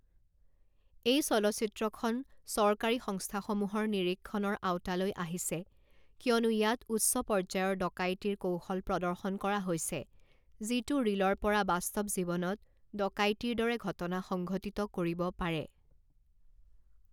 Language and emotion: Assamese, neutral